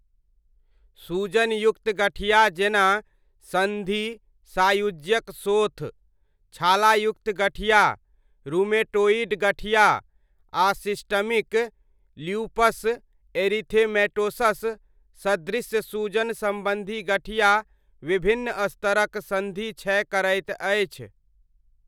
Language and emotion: Maithili, neutral